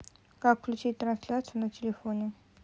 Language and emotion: Russian, neutral